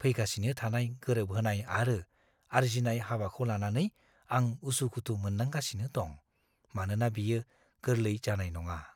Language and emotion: Bodo, fearful